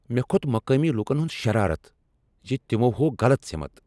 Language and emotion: Kashmiri, angry